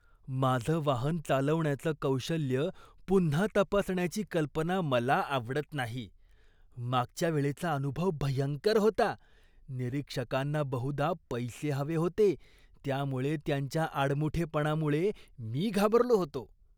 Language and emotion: Marathi, disgusted